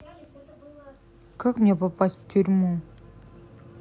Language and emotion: Russian, sad